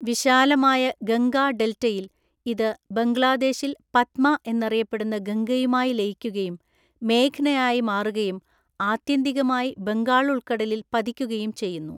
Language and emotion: Malayalam, neutral